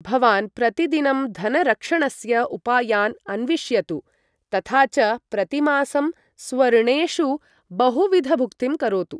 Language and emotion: Sanskrit, neutral